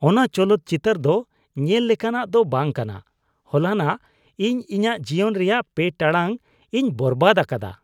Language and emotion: Santali, disgusted